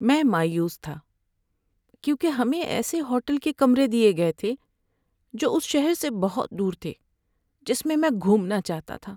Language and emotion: Urdu, sad